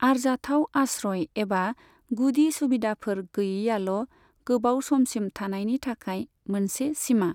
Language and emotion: Bodo, neutral